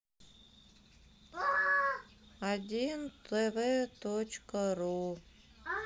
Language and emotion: Russian, sad